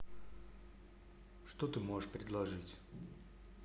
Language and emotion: Russian, neutral